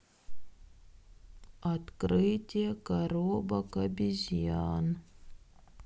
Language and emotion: Russian, sad